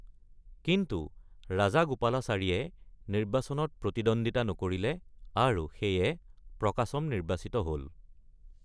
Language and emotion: Assamese, neutral